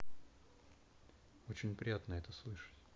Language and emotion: Russian, neutral